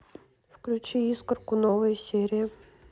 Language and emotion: Russian, neutral